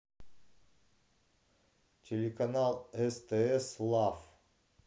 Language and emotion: Russian, neutral